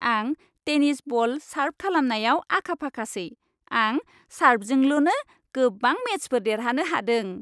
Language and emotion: Bodo, happy